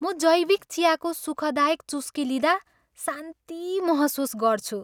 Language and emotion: Nepali, happy